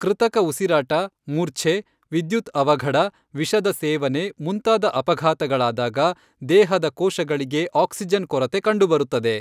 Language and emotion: Kannada, neutral